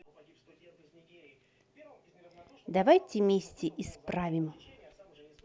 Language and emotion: Russian, positive